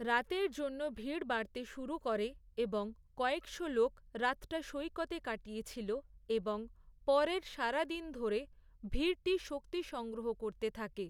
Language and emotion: Bengali, neutral